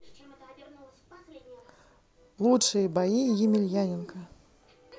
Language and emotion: Russian, positive